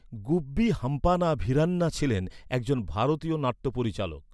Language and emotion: Bengali, neutral